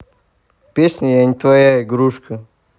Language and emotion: Russian, neutral